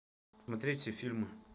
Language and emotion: Russian, neutral